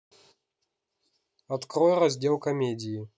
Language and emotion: Russian, neutral